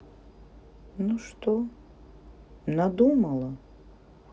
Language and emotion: Russian, sad